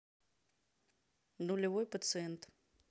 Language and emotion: Russian, neutral